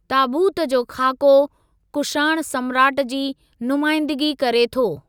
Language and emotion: Sindhi, neutral